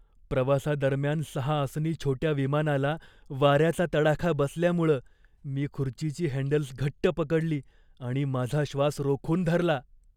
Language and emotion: Marathi, fearful